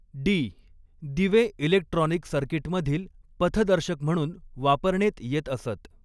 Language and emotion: Marathi, neutral